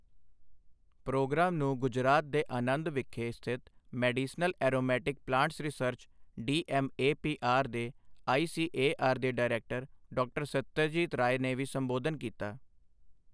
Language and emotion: Punjabi, neutral